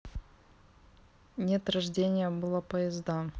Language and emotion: Russian, neutral